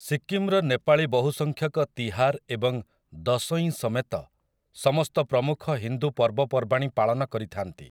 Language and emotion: Odia, neutral